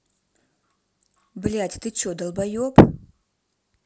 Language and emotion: Russian, angry